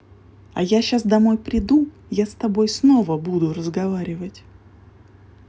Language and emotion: Russian, neutral